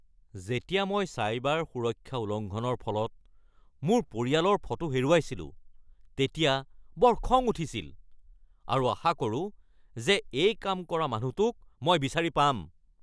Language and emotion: Assamese, angry